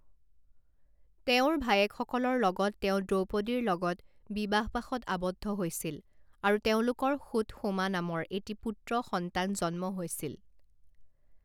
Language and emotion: Assamese, neutral